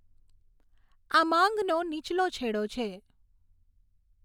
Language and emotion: Gujarati, neutral